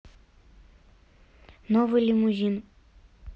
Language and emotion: Russian, neutral